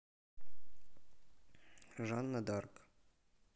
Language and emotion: Russian, neutral